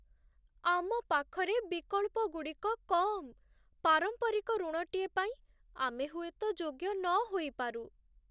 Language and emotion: Odia, sad